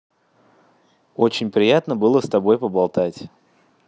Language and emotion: Russian, positive